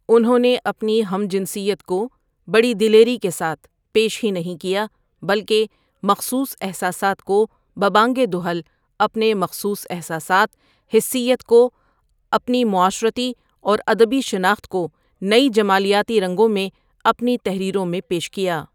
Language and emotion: Urdu, neutral